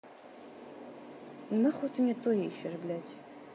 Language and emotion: Russian, angry